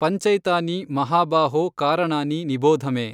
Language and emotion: Kannada, neutral